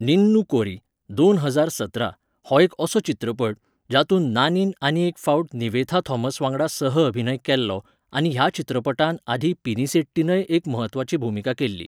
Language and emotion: Goan Konkani, neutral